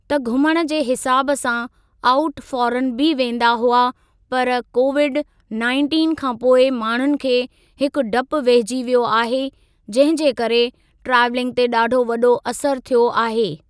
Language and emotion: Sindhi, neutral